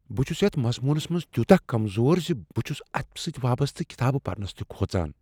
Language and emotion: Kashmiri, fearful